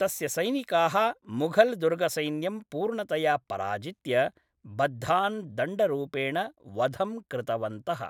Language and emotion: Sanskrit, neutral